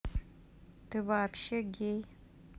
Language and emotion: Russian, neutral